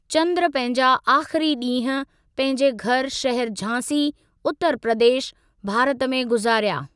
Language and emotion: Sindhi, neutral